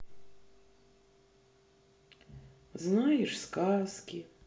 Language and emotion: Russian, sad